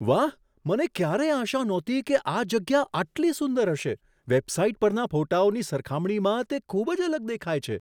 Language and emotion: Gujarati, surprised